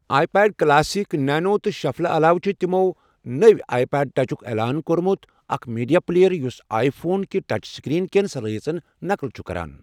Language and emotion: Kashmiri, neutral